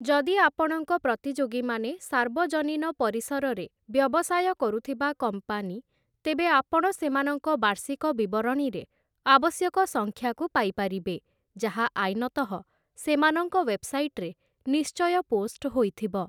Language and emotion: Odia, neutral